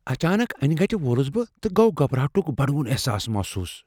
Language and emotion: Kashmiri, fearful